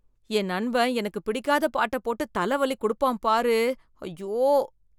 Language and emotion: Tamil, disgusted